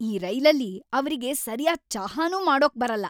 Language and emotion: Kannada, angry